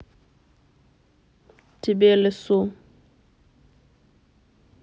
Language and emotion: Russian, neutral